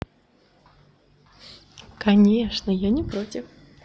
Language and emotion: Russian, positive